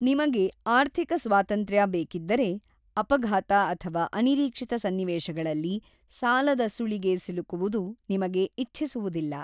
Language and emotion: Kannada, neutral